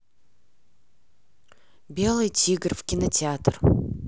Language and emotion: Russian, neutral